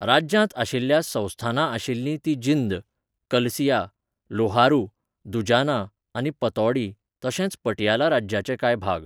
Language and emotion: Goan Konkani, neutral